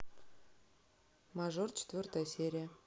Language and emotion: Russian, neutral